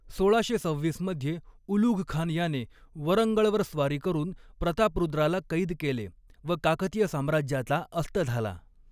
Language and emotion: Marathi, neutral